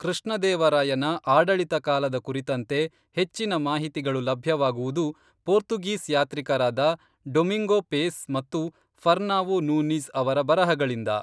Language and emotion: Kannada, neutral